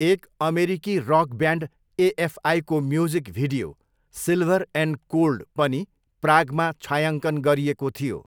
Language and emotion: Nepali, neutral